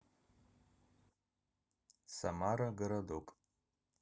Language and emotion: Russian, neutral